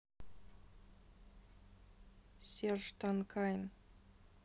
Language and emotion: Russian, sad